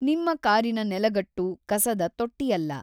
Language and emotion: Kannada, neutral